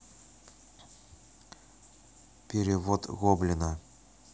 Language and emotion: Russian, neutral